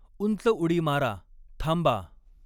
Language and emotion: Marathi, neutral